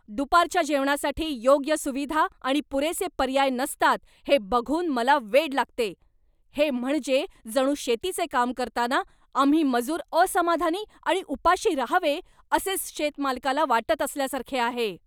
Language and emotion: Marathi, angry